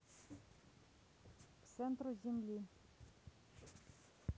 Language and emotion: Russian, neutral